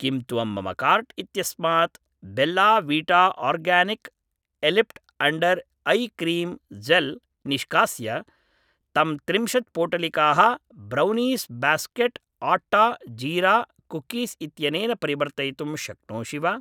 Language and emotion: Sanskrit, neutral